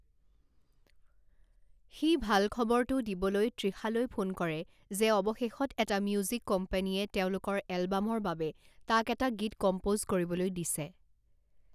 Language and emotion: Assamese, neutral